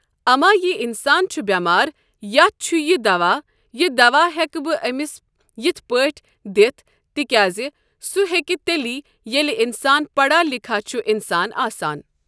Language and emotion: Kashmiri, neutral